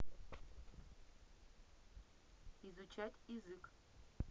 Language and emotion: Russian, neutral